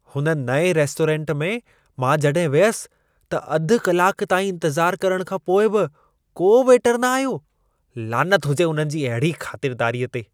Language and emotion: Sindhi, disgusted